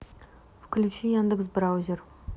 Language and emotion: Russian, neutral